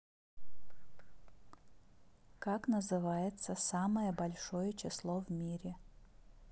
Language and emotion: Russian, neutral